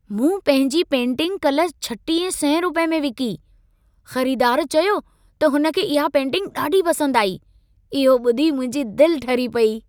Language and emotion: Sindhi, happy